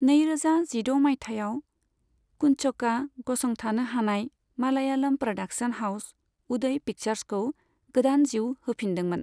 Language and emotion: Bodo, neutral